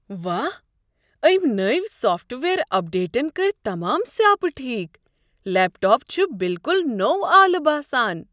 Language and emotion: Kashmiri, surprised